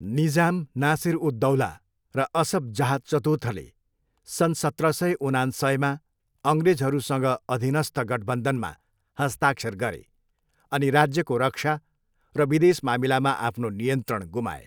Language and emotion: Nepali, neutral